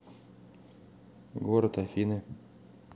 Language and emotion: Russian, neutral